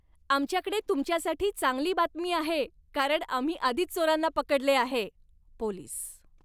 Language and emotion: Marathi, happy